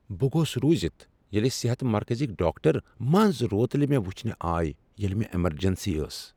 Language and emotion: Kashmiri, surprised